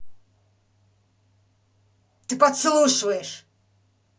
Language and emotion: Russian, angry